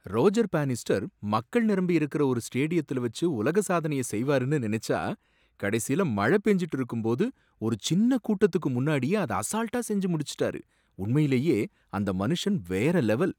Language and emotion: Tamil, surprised